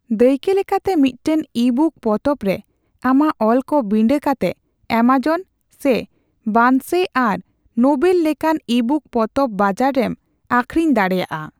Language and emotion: Santali, neutral